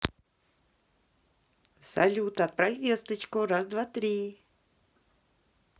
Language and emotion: Russian, positive